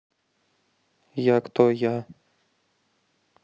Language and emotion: Russian, neutral